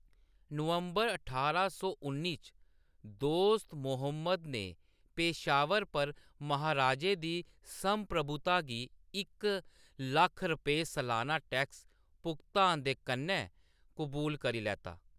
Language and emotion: Dogri, neutral